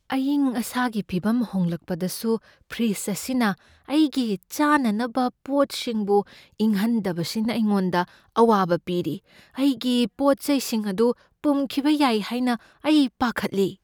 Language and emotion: Manipuri, fearful